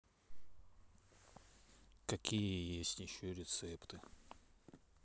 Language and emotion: Russian, neutral